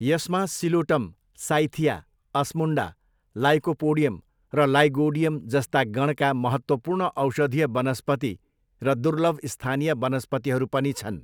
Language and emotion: Nepali, neutral